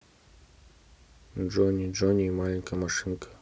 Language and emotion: Russian, neutral